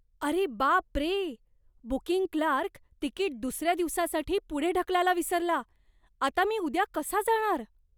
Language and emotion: Marathi, surprised